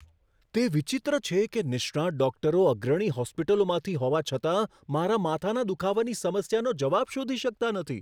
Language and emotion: Gujarati, surprised